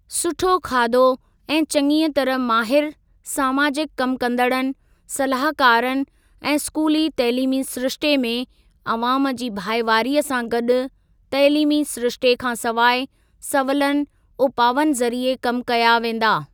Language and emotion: Sindhi, neutral